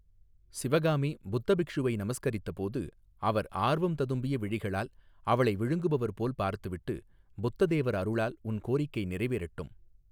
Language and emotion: Tamil, neutral